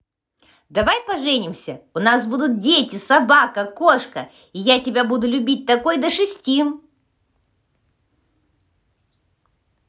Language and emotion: Russian, positive